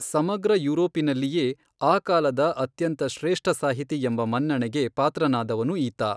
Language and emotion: Kannada, neutral